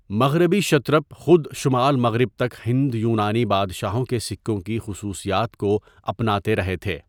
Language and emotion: Urdu, neutral